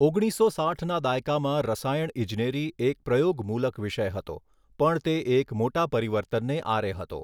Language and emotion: Gujarati, neutral